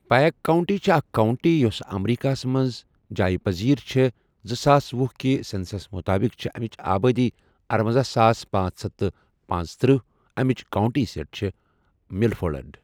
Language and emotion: Kashmiri, neutral